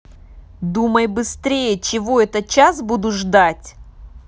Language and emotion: Russian, angry